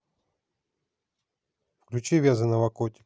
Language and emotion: Russian, neutral